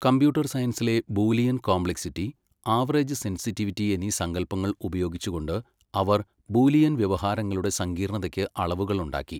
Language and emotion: Malayalam, neutral